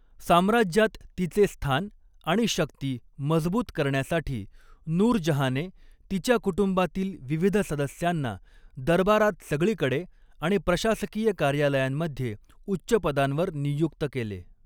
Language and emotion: Marathi, neutral